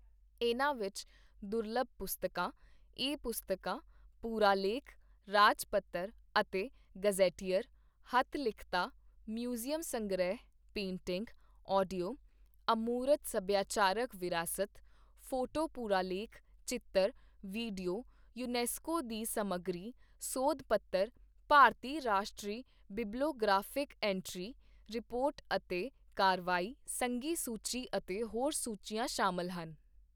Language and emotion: Punjabi, neutral